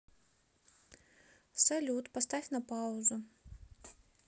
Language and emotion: Russian, neutral